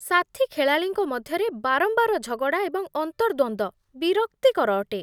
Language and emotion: Odia, disgusted